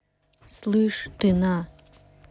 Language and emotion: Russian, angry